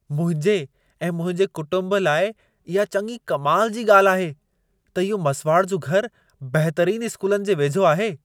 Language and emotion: Sindhi, surprised